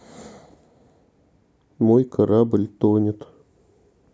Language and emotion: Russian, sad